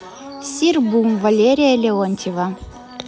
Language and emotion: Russian, neutral